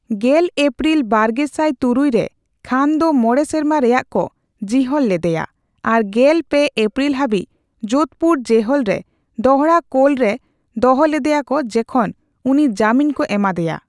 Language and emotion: Santali, neutral